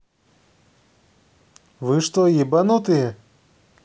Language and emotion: Russian, angry